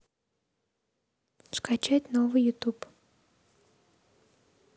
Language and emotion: Russian, neutral